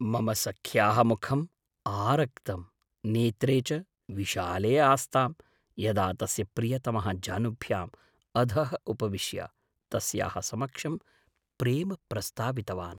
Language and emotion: Sanskrit, surprised